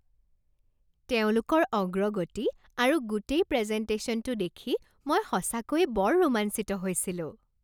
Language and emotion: Assamese, happy